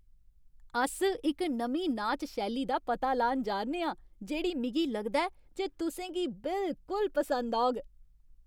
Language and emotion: Dogri, happy